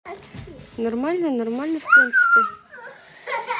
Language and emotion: Russian, neutral